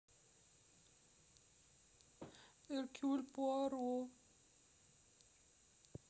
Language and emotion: Russian, sad